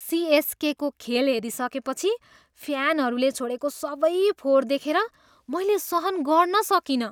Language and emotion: Nepali, disgusted